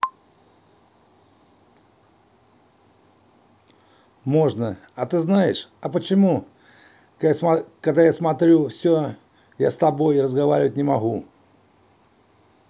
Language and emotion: Russian, neutral